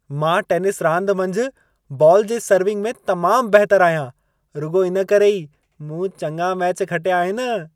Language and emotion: Sindhi, happy